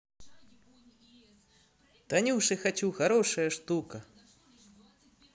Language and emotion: Russian, positive